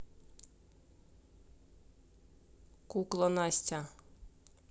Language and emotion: Russian, neutral